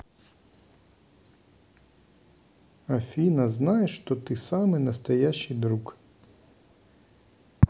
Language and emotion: Russian, neutral